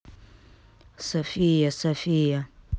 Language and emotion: Russian, neutral